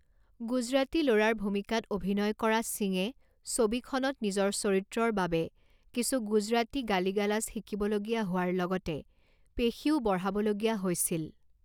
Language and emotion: Assamese, neutral